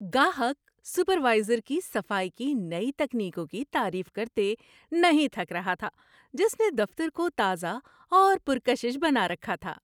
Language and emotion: Urdu, happy